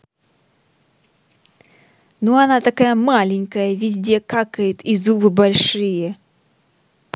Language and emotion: Russian, angry